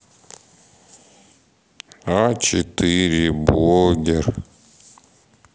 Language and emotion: Russian, sad